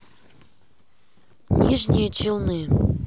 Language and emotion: Russian, neutral